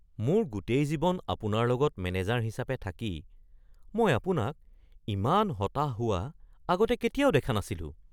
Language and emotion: Assamese, surprised